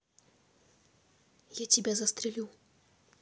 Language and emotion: Russian, neutral